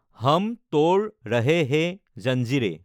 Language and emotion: Assamese, neutral